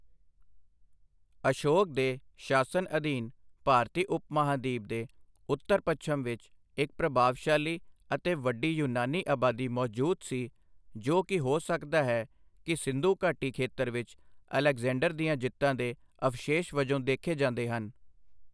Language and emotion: Punjabi, neutral